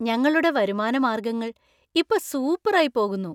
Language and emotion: Malayalam, happy